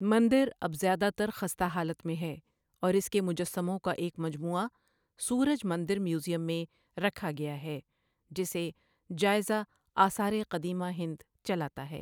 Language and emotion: Urdu, neutral